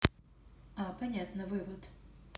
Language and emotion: Russian, neutral